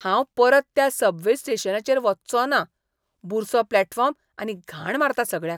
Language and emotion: Goan Konkani, disgusted